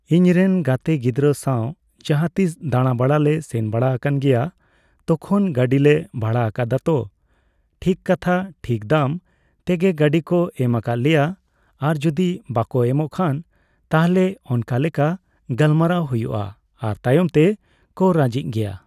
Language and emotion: Santali, neutral